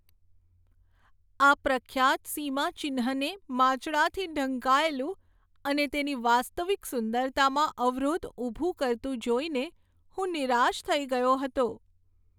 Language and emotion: Gujarati, sad